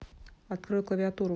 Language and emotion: Russian, neutral